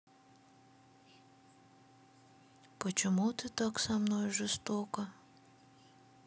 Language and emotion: Russian, sad